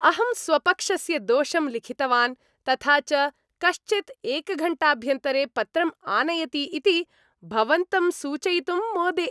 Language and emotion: Sanskrit, happy